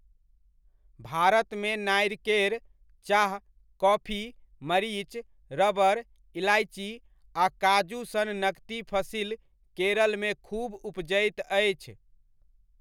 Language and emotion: Maithili, neutral